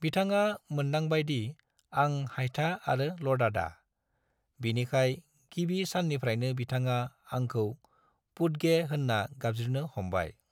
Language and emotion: Bodo, neutral